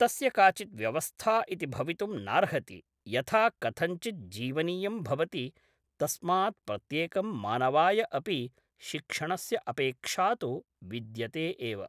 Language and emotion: Sanskrit, neutral